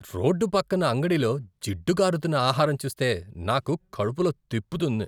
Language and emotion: Telugu, disgusted